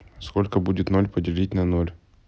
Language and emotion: Russian, neutral